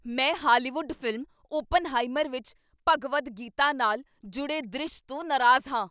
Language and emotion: Punjabi, angry